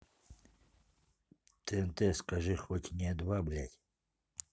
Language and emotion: Russian, neutral